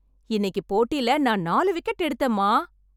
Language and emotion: Tamil, happy